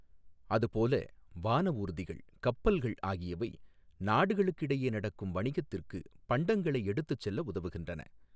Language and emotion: Tamil, neutral